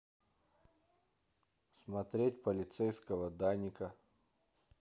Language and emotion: Russian, neutral